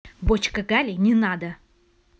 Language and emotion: Russian, angry